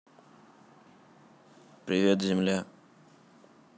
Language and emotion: Russian, neutral